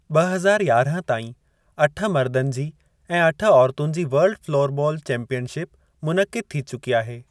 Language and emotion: Sindhi, neutral